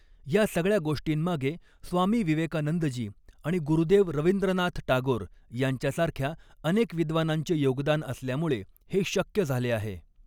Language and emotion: Marathi, neutral